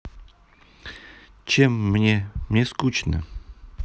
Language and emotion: Russian, neutral